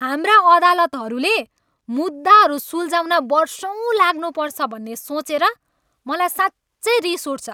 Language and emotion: Nepali, angry